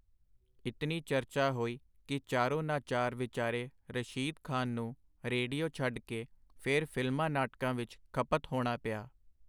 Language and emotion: Punjabi, neutral